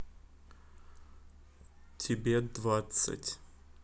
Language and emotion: Russian, neutral